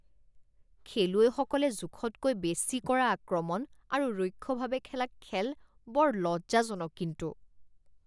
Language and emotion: Assamese, disgusted